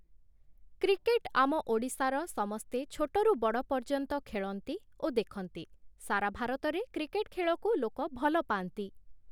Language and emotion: Odia, neutral